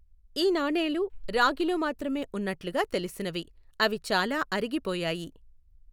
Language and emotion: Telugu, neutral